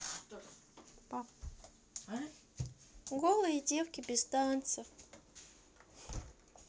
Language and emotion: Russian, sad